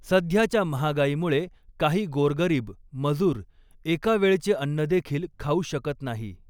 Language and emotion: Marathi, neutral